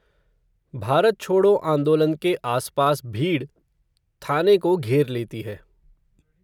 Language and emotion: Hindi, neutral